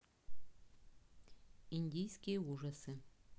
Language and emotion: Russian, neutral